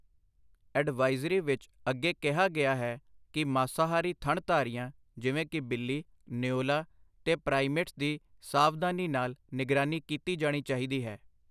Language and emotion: Punjabi, neutral